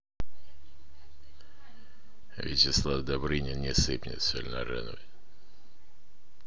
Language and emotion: Russian, neutral